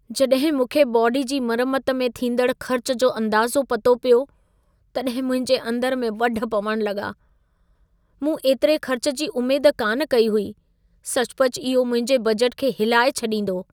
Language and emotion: Sindhi, sad